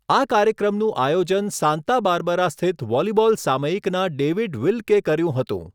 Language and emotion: Gujarati, neutral